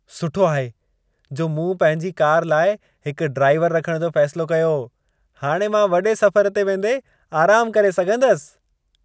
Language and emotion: Sindhi, happy